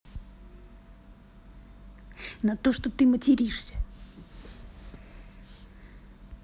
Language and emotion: Russian, neutral